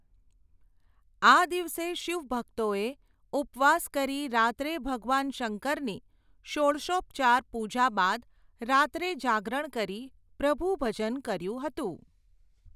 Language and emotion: Gujarati, neutral